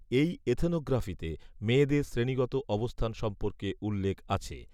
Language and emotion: Bengali, neutral